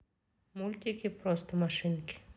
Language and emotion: Russian, neutral